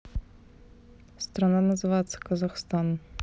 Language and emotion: Russian, neutral